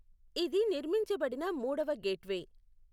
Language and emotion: Telugu, neutral